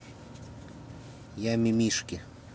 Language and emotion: Russian, neutral